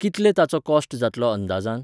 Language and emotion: Goan Konkani, neutral